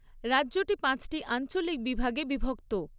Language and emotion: Bengali, neutral